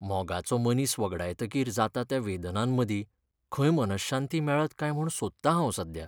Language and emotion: Goan Konkani, sad